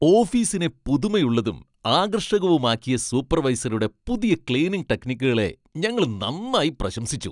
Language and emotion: Malayalam, happy